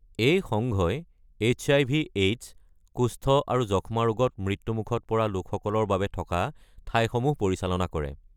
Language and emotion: Assamese, neutral